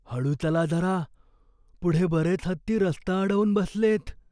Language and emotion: Marathi, fearful